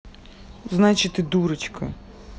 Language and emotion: Russian, neutral